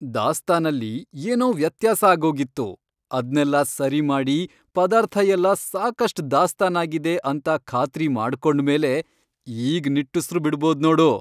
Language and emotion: Kannada, happy